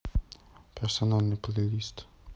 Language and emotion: Russian, neutral